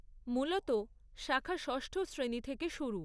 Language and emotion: Bengali, neutral